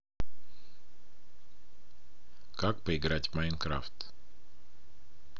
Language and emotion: Russian, neutral